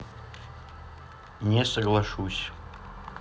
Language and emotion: Russian, neutral